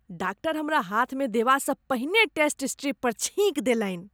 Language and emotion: Maithili, disgusted